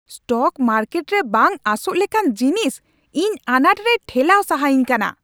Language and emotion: Santali, angry